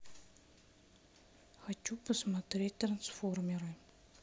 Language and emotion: Russian, sad